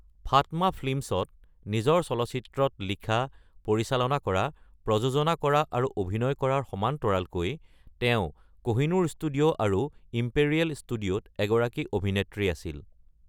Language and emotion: Assamese, neutral